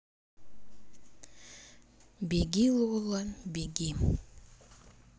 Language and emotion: Russian, sad